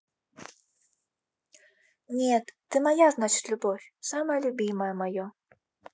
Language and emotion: Russian, neutral